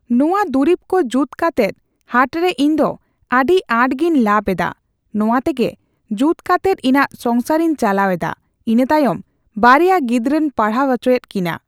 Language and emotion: Santali, neutral